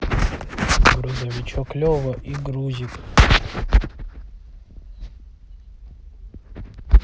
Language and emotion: Russian, neutral